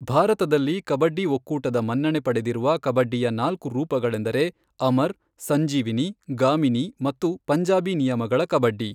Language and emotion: Kannada, neutral